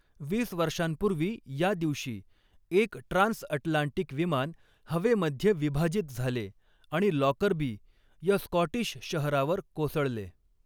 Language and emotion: Marathi, neutral